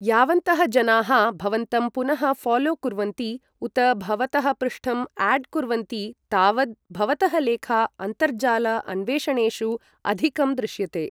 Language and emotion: Sanskrit, neutral